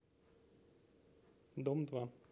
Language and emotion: Russian, neutral